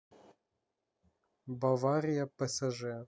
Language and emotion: Russian, neutral